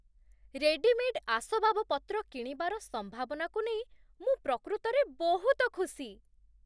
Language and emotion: Odia, surprised